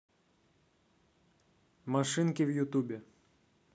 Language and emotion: Russian, neutral